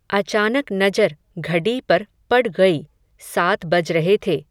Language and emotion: Hindi, neutral